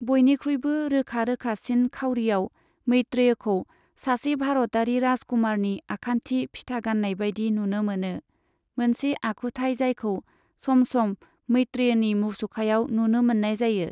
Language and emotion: Bodo, neutral